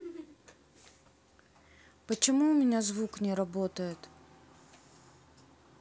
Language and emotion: Russian, sad